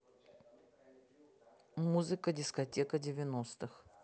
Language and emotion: Russian, neutral